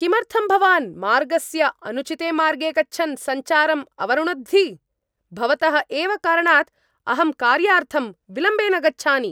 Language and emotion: Sanskrit, angry